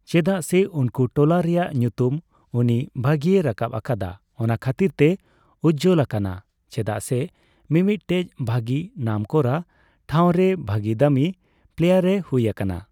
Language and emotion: Santali, neutral